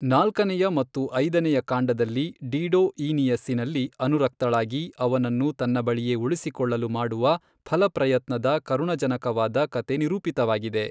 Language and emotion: Kannada, neutral